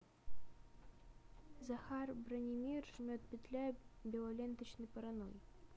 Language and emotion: Russian, neutral